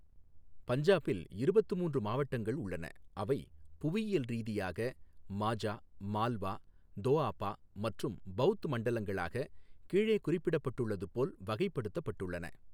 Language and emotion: Tamil, neutral